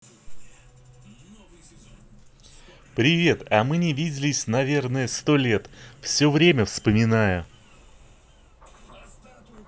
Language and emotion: Russian, positive